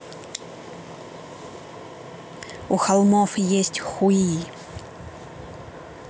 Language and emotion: Russian, neutral